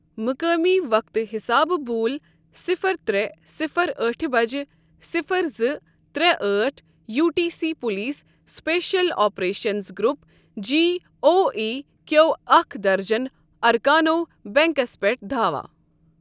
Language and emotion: Kashmiri, neutral